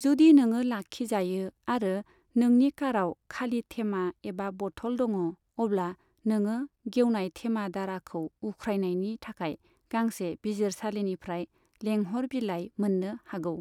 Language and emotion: Bodo, neutral